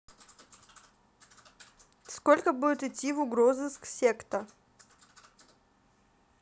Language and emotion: Russian, neutral